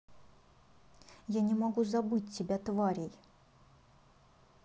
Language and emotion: Russian, angry